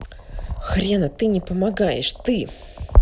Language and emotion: Russian, angry